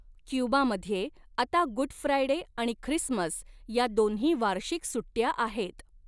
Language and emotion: Marathi, neutral